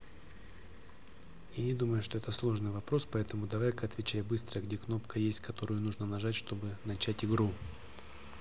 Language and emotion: Russian, neutral